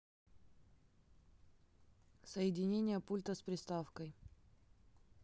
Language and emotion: Russian, neutral